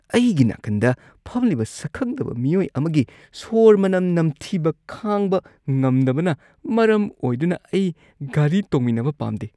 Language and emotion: Manipuri, disgusted